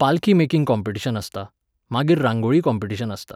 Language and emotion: Goan Konkani, neutral